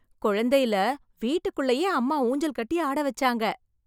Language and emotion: Tamil, happy